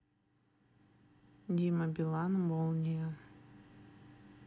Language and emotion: Russian, neutral